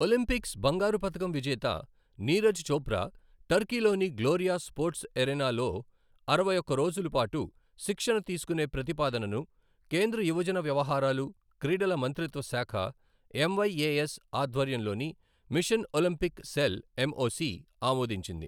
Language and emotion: Telugu, neutral